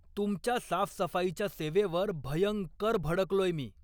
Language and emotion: Marathi, angry